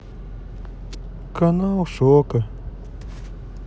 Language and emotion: Russian, sad